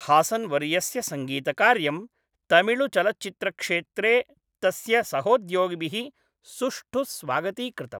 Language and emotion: Sanskrit, neutral